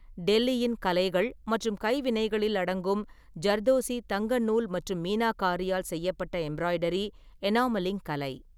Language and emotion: Tamil, neutral